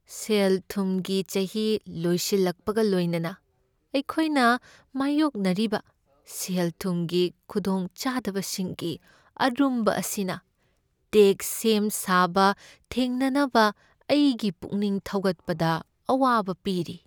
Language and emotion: Manipuri, sad